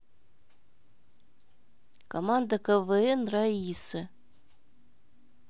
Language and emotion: Russian, neutral